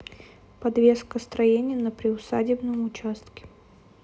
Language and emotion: Russian, neutral